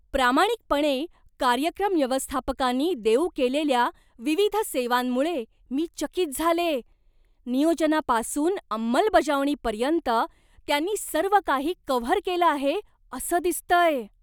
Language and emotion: Marathi, surprised